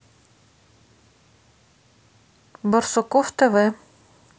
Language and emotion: Russian, neutral